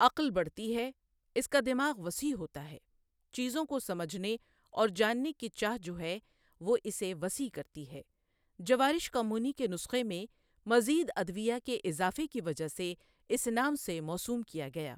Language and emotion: Urdu, neutral